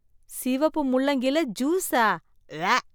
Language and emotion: Tamil, disgusted